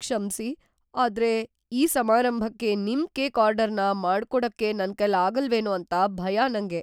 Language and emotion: Kannada, fearful